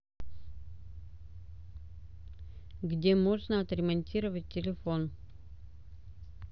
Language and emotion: Russian, neutral